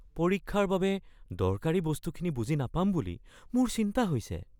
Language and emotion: Assamese, fearful